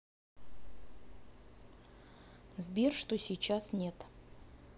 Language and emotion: Russian, neutral